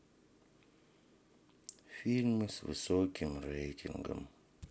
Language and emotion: Russian, sad